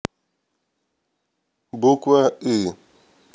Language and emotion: Russian, neutral